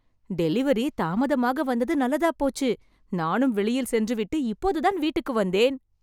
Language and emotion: Tamil, happy